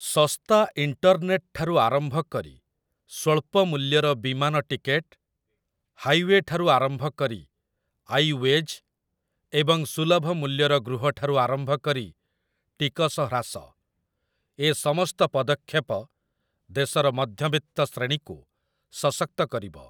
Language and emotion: Odia, neutral